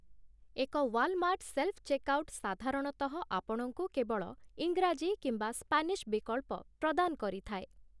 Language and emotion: Odia, neutral